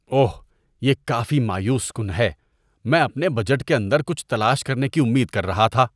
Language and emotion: Urdu, disgusted